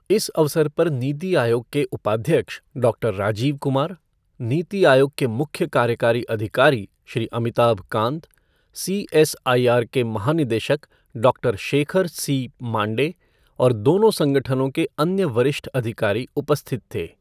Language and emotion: Hindi, neutral